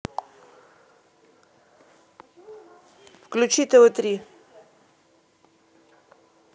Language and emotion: Russian, neutral